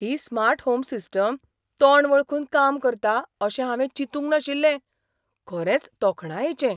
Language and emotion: Goan Konkani, surprised